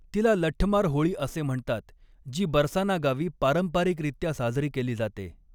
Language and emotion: Marathi, neutral